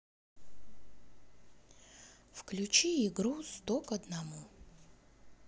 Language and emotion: Russian, neutral